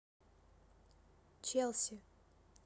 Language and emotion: Russian, neutral